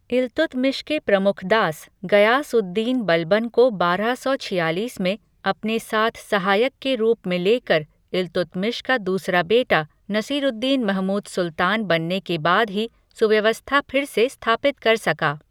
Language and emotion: Hindi, neutral